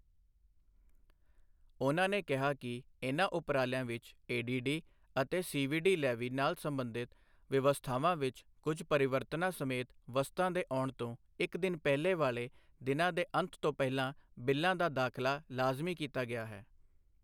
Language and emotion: Punjabi, neutral